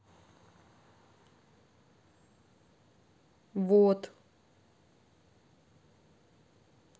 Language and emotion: Russian, neutral